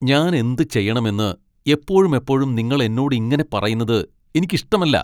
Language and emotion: Malayalam, angry